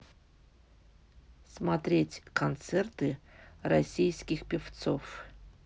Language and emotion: Russian, neutral